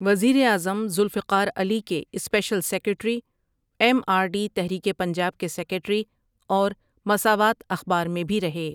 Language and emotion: Urdu, neutral